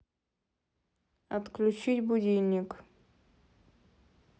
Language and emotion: Russian, neutral